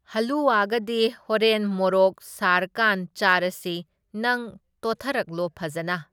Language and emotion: Manipuri, neutral